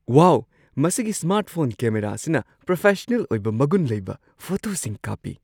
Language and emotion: Manipuri, surprised